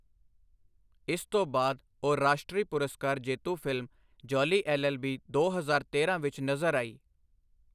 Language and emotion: Punjabi, neutral